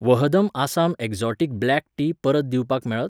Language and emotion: Goan Konkani, neutral